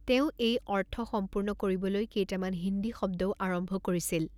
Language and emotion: Assamese, neutral